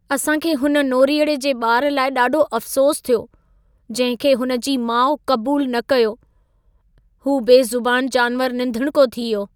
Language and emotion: Sindhi, sad